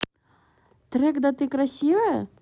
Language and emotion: Russian, neutral